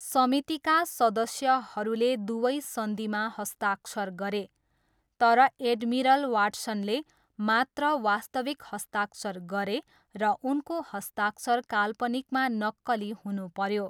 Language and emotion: Nepali, neutral